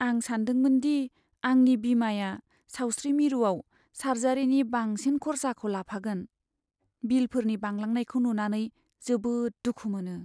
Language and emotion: Bodo, sad